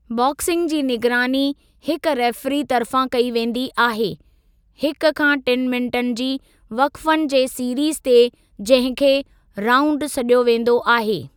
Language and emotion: Sindhi, neutral